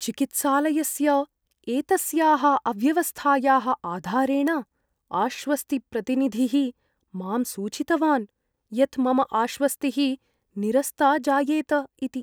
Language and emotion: Sanskrit, fearful